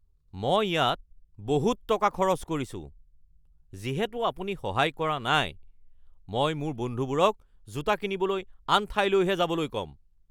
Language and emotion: Assamese, angry